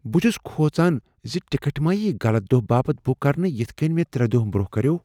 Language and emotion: Kashmiri, fearful